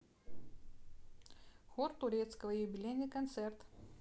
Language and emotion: Russian, neutral